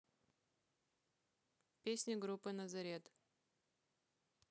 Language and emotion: Russian, neutral